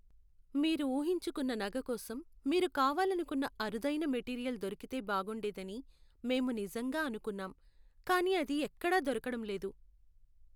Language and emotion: Telugu, sad